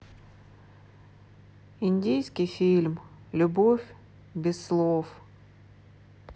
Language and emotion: Russian, sad